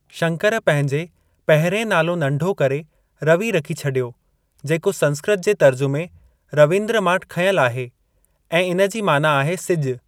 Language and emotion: Sindhi, neutral